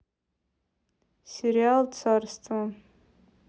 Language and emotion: Russian, neutral